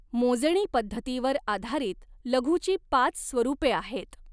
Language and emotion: Marathi, neutral